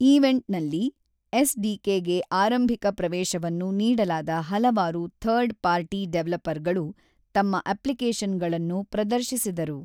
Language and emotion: Kannada, neutral